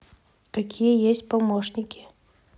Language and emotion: Russian, neutral